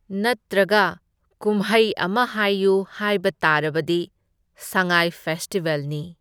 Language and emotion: Manipuri, neutral